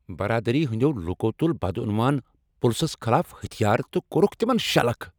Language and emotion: Kashmiri, angry